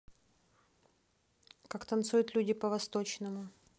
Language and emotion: Russian, neutral